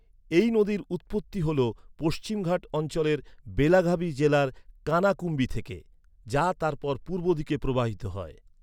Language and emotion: Bengali, neutral